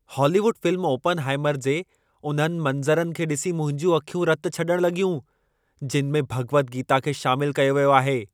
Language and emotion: Sindhi, angry